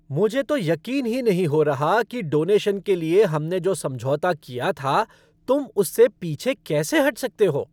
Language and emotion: Hindi, angry